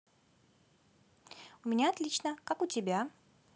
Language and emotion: Russian, positive